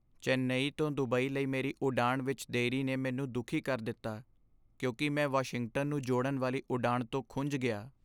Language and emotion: Punjabi, sad